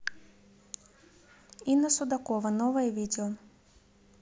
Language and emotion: Russian, neutral